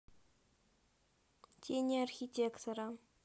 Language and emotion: Russian, neutral